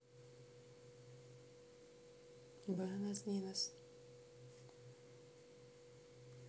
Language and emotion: Russian, neutral